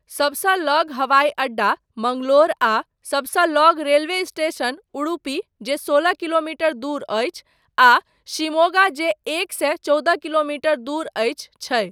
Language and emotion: Maithili, neutral